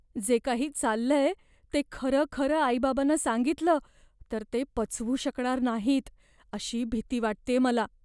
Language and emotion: Marathi, fearful